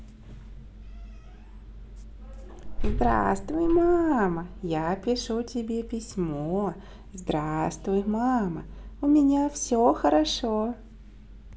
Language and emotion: Russian, positive